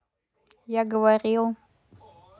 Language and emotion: Russian, neutral